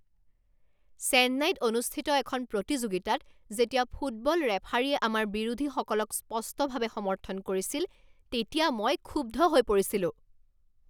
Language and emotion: Assamese, angry